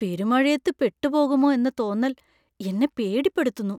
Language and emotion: Malayalam, fearful